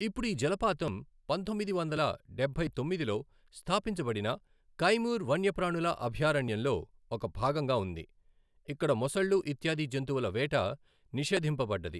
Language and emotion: Telugu, neutral